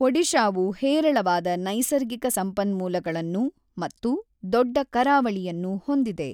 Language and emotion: Kannada, neutral